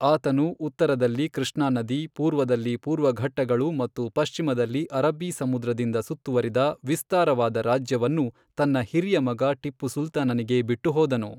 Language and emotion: Kannada, neutral